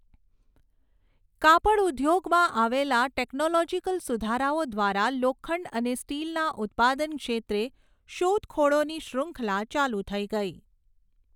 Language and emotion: Gujarati, neutral